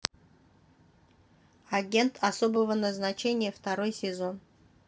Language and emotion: Russian, neutral